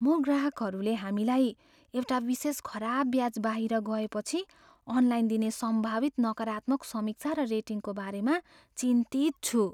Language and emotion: Nepali, fearful